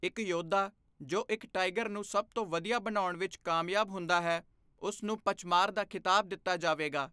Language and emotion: Punjabi, neutral